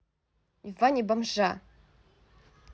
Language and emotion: Russian, angry